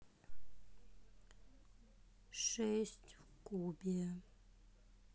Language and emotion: Russian, sad